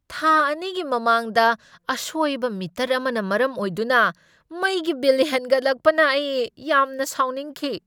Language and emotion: Manipuri, angry